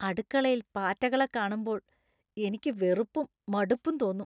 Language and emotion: Malayalam, disgusted